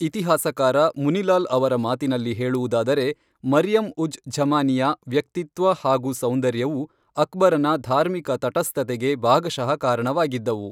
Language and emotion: Kannada, neutral